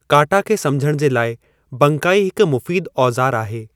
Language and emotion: Sindhi, neutral